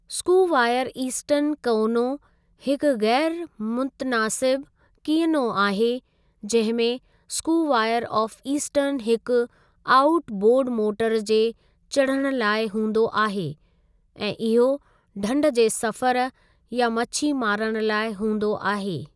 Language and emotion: Sindhi, neutral